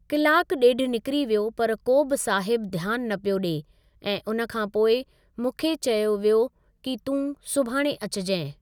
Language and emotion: Sindhi, neutral